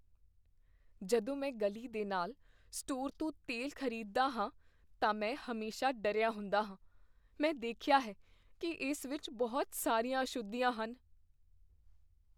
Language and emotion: Punjabi, fearful